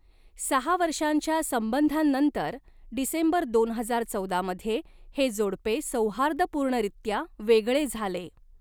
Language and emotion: Marathi, neutral